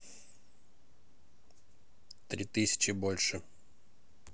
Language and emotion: Russian, neutral